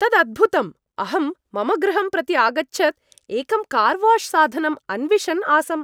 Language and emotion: Sanskrit, happy